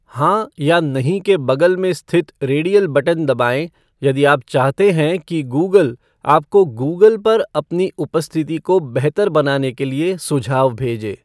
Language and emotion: Hindi, neutral